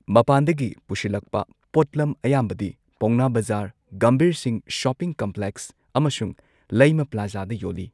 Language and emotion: Manipuri, neutral